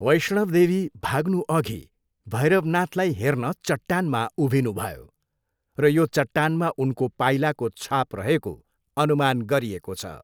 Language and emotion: Nepali, neutral